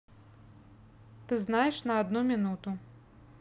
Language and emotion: Russian, neutral